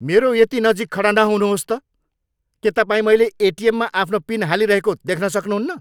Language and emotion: Nepali, angry